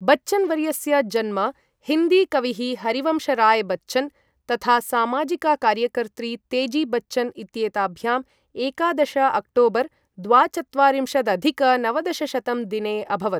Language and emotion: Sanskrit, neutral